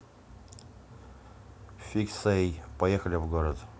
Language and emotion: Russian, neutral